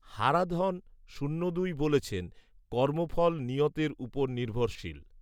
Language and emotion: Bengali, neutral